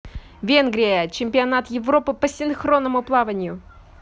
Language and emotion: Russian, positive